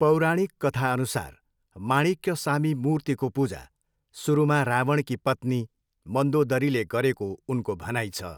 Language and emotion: Nepali, neutral